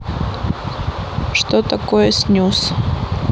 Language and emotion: Russian, neutral